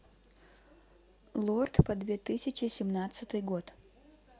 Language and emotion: Russian, neutral